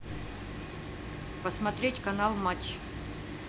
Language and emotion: Russian, neutral